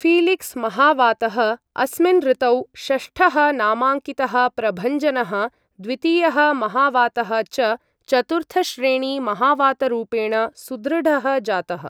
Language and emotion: Sanskrit, neutral